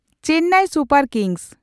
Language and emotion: Santali, neutral